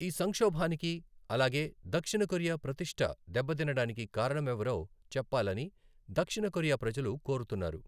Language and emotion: Telugu, neutral